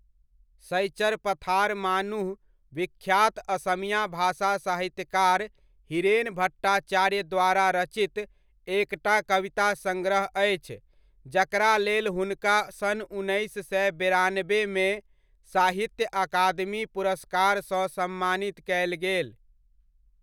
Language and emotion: Maithili, neutral